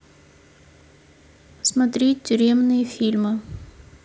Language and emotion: Russian, neutral